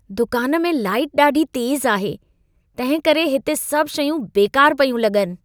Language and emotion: Sindhi, disgusted